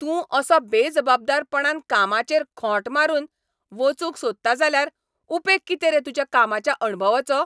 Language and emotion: Goan Konkani, angry